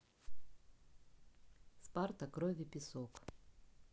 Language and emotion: Russian, neutral